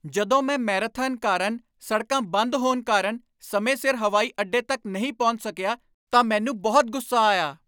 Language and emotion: Punjabi, angry